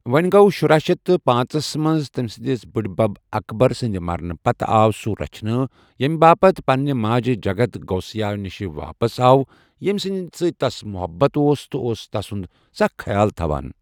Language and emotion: Kashmiri, neutral